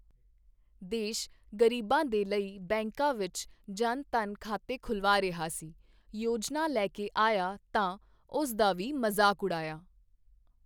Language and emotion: Punjabi, neutral